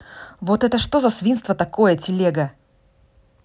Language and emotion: Russian, angry